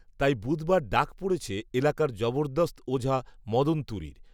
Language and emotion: Bengali, neutral